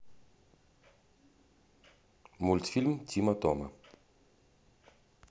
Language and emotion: Russian, neutral